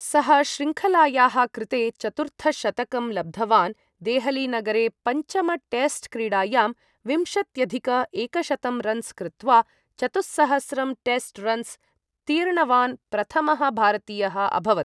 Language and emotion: Sanskrit, neutral